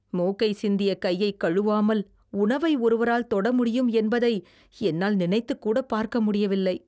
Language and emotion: Tamil, disgusted